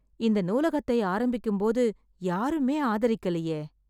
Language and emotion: Tamil, sad